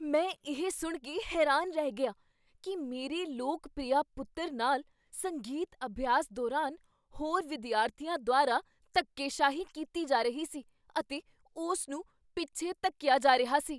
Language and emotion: Punjabi, surprised